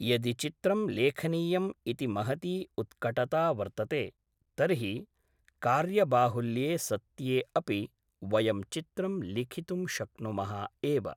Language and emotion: Sanskrit, neutral